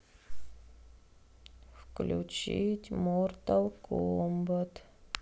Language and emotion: Russian, sad